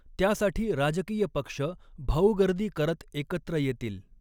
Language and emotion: Marathi, neutral